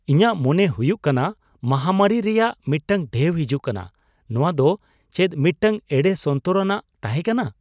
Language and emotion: Santali, surprised